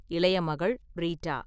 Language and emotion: Tamil, neutral